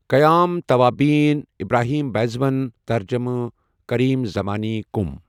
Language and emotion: Kashmiri, neutral